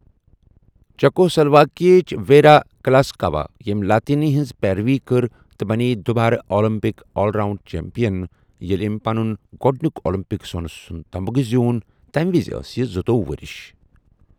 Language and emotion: Kashmiri, neutral